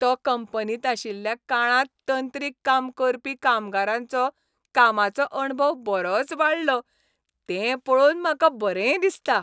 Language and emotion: Goan Konkani, happy